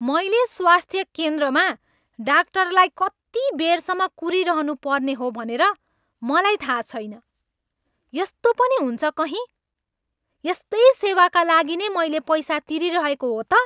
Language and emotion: Nepali, angry